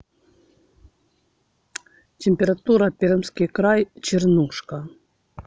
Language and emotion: Russian, neutral